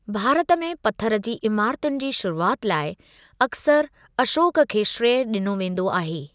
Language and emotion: Sindhi, neutral